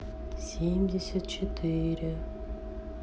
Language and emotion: Russian, sad